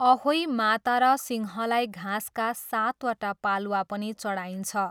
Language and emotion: Nepali, neutral